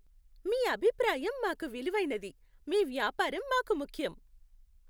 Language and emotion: Telugu, happy